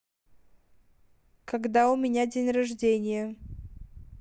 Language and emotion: Russian, neutral